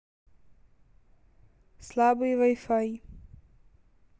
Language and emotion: Russian, neutral